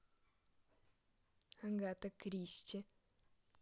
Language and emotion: Russian, neutral